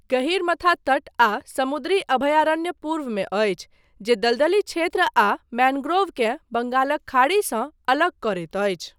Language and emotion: Maithili, neutral